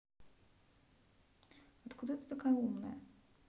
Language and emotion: Russian, neutral